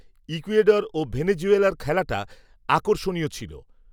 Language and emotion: Bengali, neutral